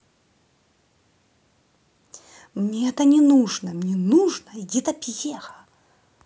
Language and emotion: Russian, angry